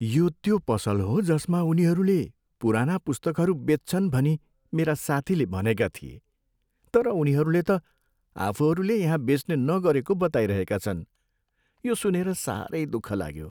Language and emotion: Nepali, sad